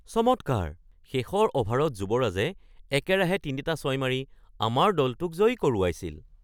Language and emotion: Assamese, surprised